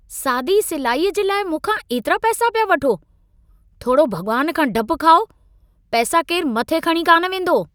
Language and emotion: Sindhi, angry